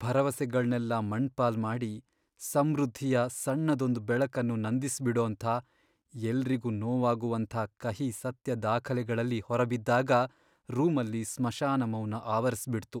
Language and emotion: Kannada, sad